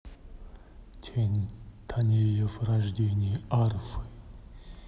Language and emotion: Russian, neutral